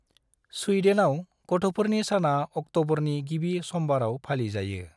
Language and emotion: Bodo, neutral